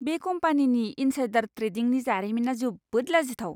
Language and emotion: Bodo, disgusted